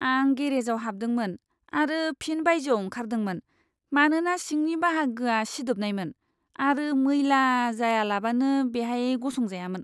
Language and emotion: Bodo, disgusted